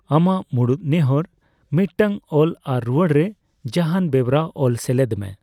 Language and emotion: Santali, neutral